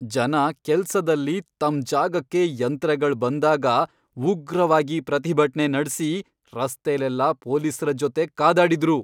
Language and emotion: Kannada, angry